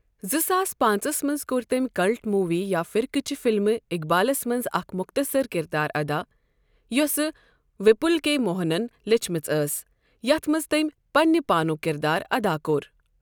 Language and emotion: Kashmiri, neutral